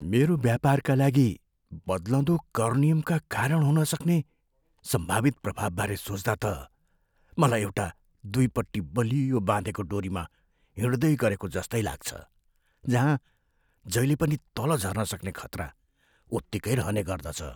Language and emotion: Nepali, fearful